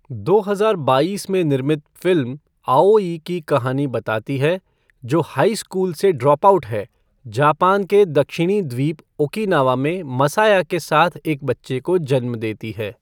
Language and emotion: Hindi, neutral